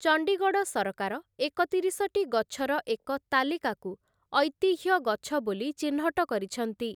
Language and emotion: Odia, neutral